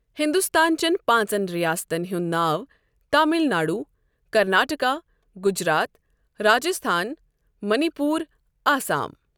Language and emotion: Kashmiri, neutral